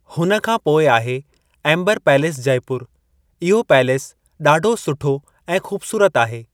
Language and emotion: Sindhi, neutral